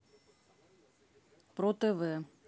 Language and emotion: Russian, neutral